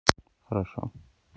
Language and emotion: Russian, neutral